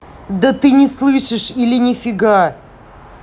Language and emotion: Russian, angry